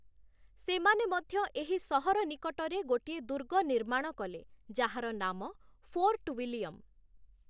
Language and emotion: Odia, neutral